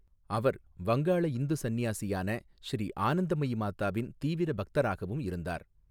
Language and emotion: Tamil, neutral